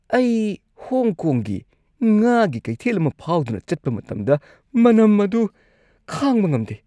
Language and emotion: Manipuri, disgusted